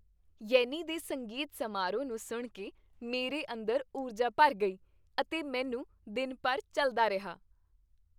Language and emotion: Punjabi, happy